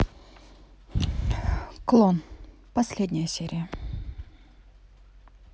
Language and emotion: Russian, neutral